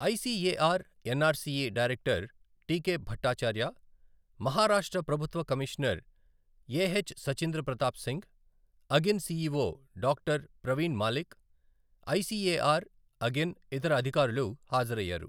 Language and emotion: Telugu, neutral